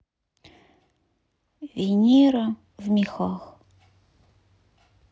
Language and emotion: Russian, sad